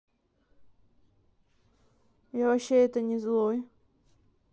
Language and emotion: Russian, neutral